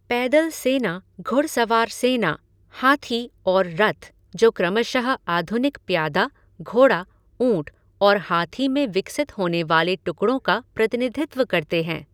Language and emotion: Hindi, neutral